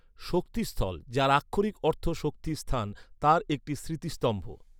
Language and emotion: Bengali, neutral